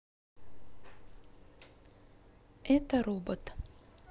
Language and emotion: Russian, neutral